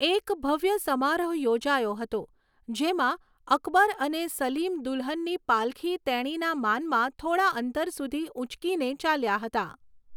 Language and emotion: Gujarati, neutral